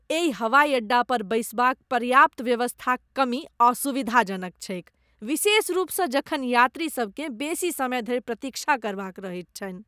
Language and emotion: Maithili, disgusted